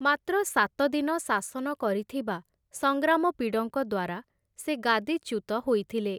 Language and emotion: Odia, neutral